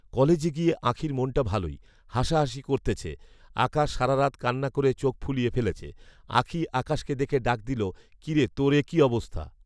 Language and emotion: Bengali, neutral